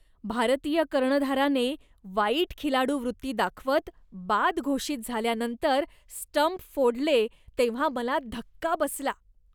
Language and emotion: Marathi, disgusted